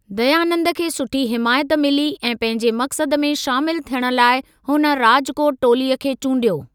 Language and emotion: Sindhi, neutral